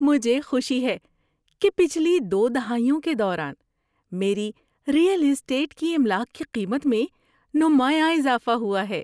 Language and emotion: Urdu, happy